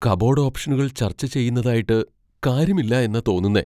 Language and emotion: Malayalam, fearful